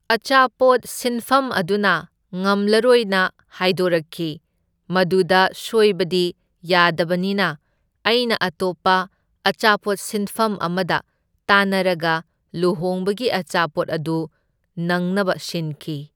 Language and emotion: Manipuri, neutral